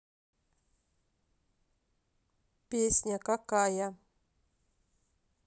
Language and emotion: Russian, neutral